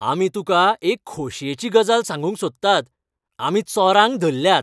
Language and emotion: Goan Konkani, happy